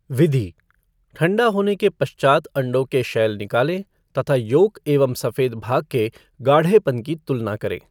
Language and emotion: Hindi, neutral